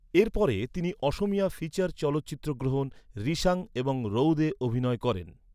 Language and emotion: Bengali, neutral